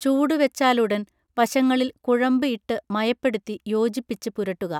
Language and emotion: Malayalam, neutral